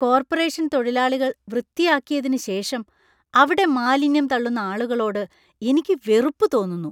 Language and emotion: Malayalam, disgusted